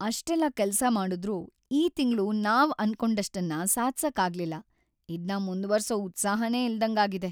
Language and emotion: Kannada, sad